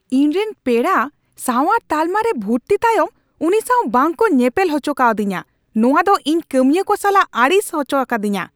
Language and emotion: Santali, angry